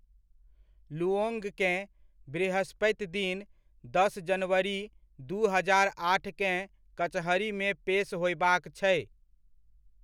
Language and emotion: Maithili, neutral